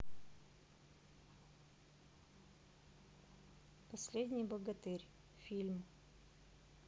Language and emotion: Russian, neutral